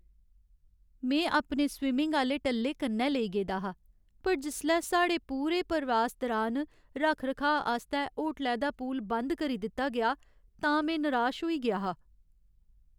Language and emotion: Dogri, sad